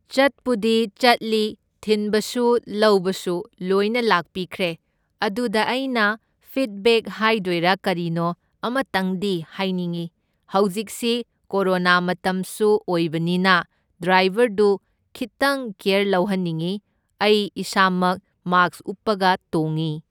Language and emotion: Manipuri, neutral